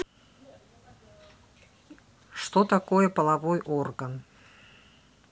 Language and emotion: Russian, neutral